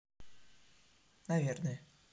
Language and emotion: Russian, neutral